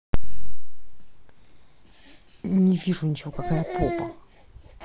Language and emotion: Russian, neutral